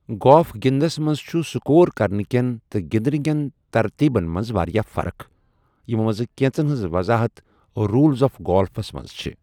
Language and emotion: Kashmiri, neutral